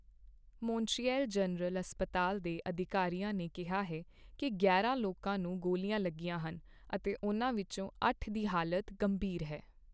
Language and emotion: Punjabi, neutral